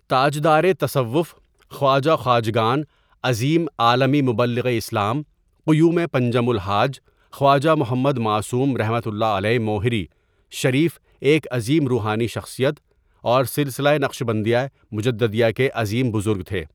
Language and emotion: Urdu, neutral